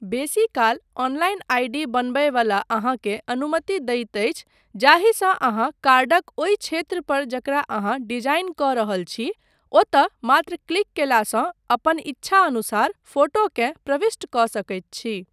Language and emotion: Maithili, neutral